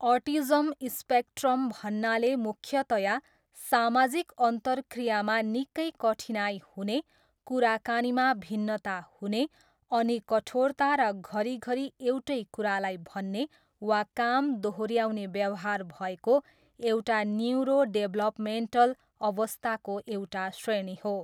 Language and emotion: Nepali, neutral